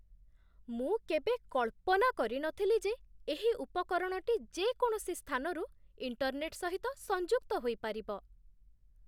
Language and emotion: Odia, surprised